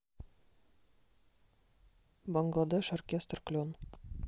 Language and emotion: Russian, neutral